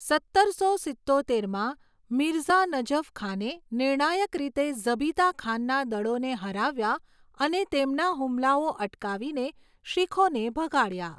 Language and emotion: Gujarati, neutral